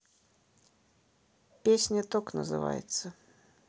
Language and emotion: Russian, neutral